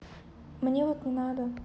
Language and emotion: Russian, neutral